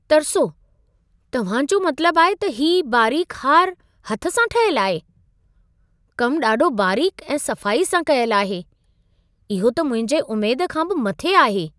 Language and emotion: Sindhi, surprised